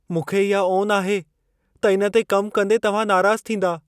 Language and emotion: Sindhi, fearful